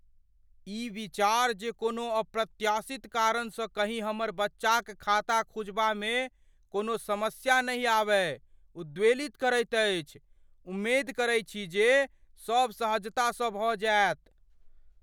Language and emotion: Maithili, fearful